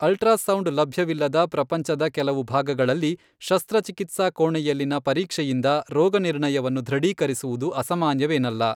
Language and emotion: Kannada, neutral